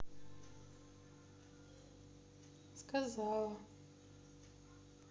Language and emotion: Russian, sad